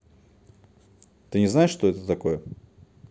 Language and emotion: Russian, neutral